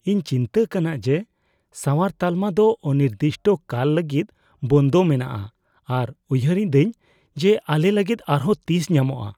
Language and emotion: Santali, fearful